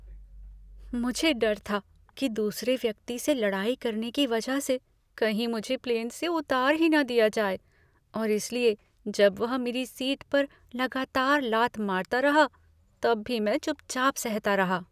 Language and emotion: Hindi, fearful